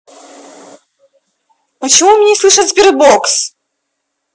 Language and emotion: Russian, angry